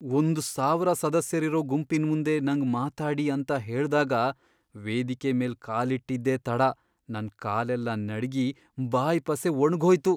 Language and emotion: Kannada, fearful